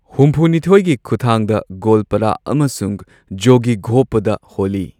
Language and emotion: Manipuri, neutral